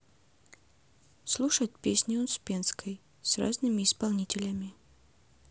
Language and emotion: Russian, neutral